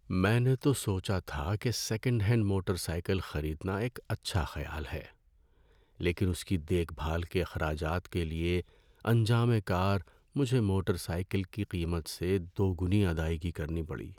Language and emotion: Urdu, sad